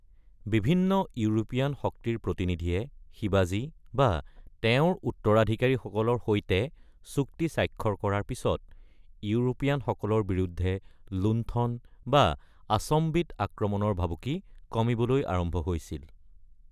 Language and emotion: Assamese, neutral